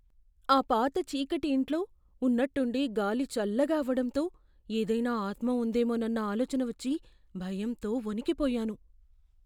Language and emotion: Telugu, fearful